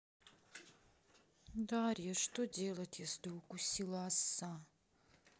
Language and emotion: Russian, sad